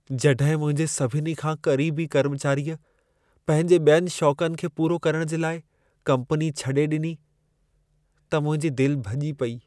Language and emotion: Sindhi, sad